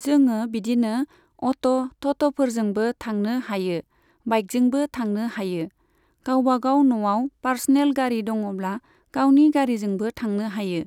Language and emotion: Bodo, neutral